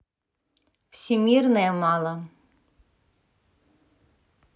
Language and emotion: Russian, neutral